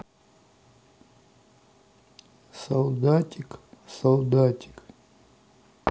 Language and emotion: Russian, sad